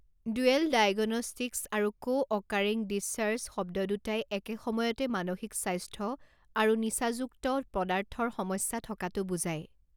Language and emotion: Assamese, neutral